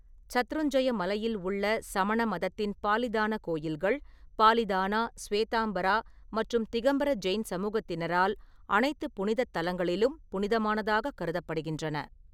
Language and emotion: Tamil, neutral